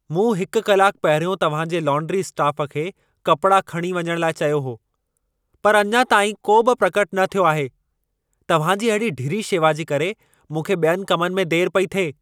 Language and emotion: Sindhi, angry